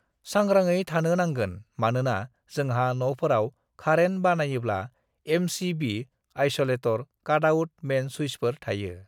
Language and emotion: Bodo, neutral